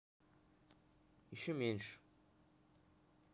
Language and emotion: Russian, neutral